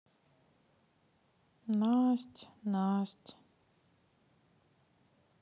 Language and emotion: Russian, sad